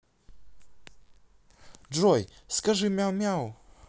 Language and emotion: Russian, positive